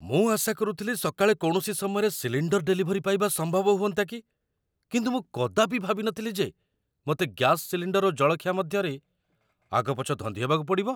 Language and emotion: Odia, surprised